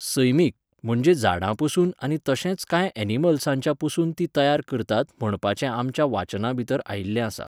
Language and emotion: Goan Konkani, neutral